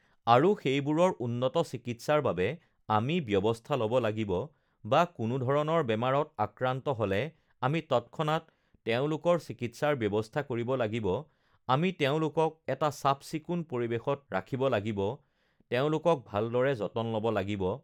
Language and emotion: Assamese, neutral